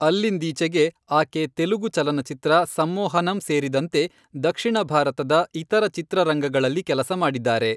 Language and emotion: Kannada, neutral